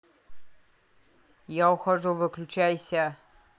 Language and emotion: Russian, angry